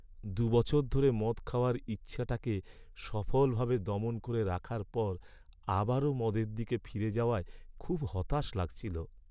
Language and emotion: Bengali, sad